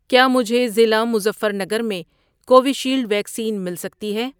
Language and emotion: Urdu, neutral